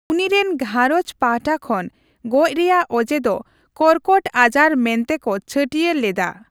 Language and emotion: Santali, neutral